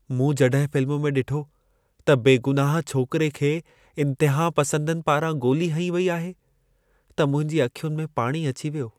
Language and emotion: Sindhi, sad